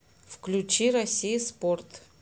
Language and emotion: Russian, neutral